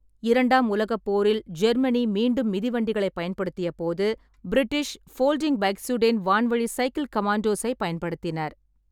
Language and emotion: Tamil, neutral